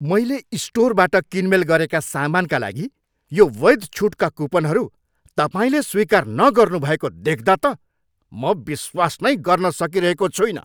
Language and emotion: Nepali, angry